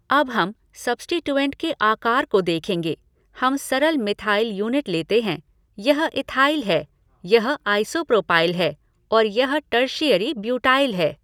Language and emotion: Hindi, neutral